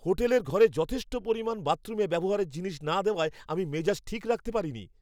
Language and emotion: Bengali, angry